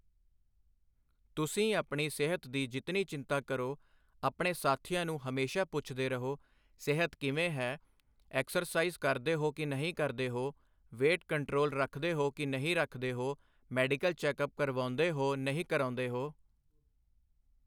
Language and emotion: Punjabi, neutral